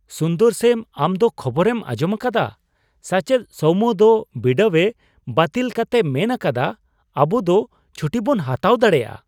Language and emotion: Santali, surprised